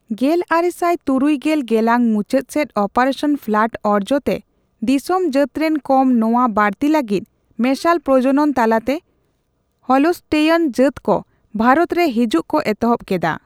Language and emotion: Santali, neutral